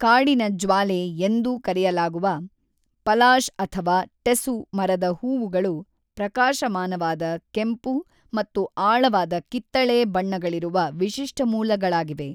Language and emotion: Kannada, neutral